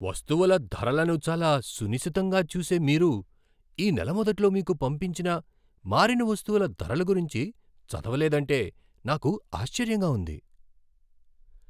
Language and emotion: Telugu, surprised